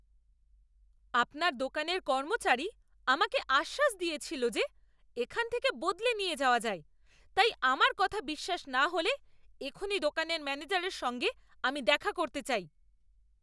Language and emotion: Bengali, angry